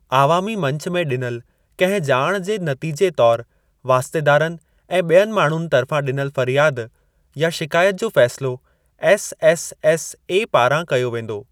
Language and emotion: Sindhi, neutral